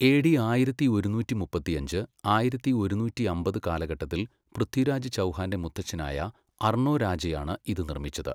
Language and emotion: Malayalam, neutral